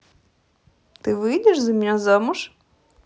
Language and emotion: Russian, positive